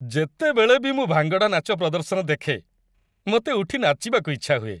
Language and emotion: Odia, happy